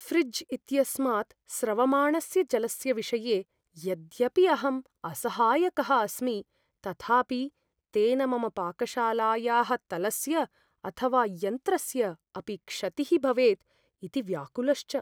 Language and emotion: Sanskrit, fearful